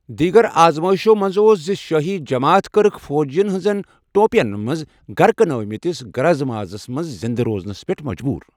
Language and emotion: Kashmiri, neutral